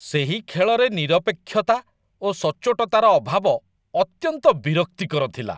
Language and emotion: Odia, disgusted